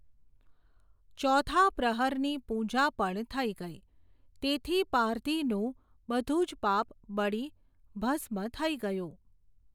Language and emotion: Gujarati, neutral